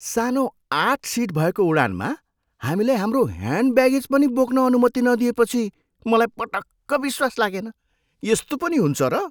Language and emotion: Nepali, surprised